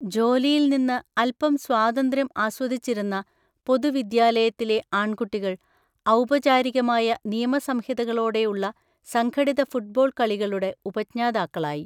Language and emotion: Malayalam, neutral